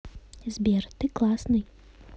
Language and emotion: Russian, neutral